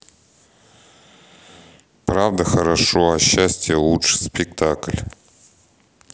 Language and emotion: Russian, neutral